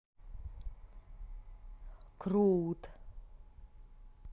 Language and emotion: Russian, positive